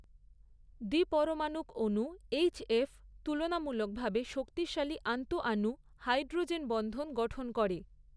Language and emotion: Bengali, neutral